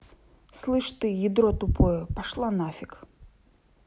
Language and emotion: Russian, angry